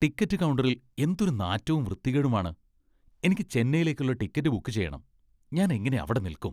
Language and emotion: Malayalam, disgusted